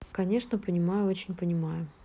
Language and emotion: Russian, neutral